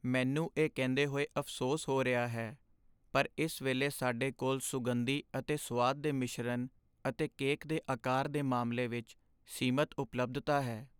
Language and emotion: Punjabi, sad